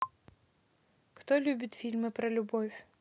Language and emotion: Russian, neutral